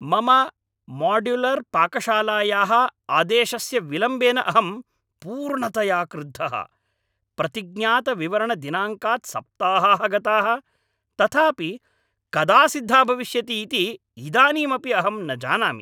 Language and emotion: Sanskrit, angry